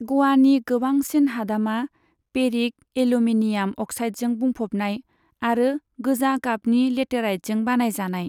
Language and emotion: Bodo, neutral